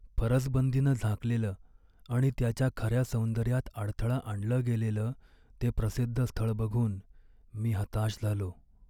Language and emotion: Marathi, sad